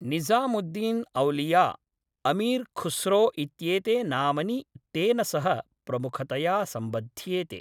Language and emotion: Sanskrit, neutral